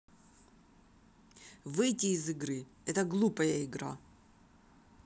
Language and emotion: Russian, angry